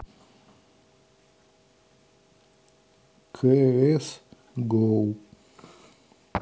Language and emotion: Russian, neutral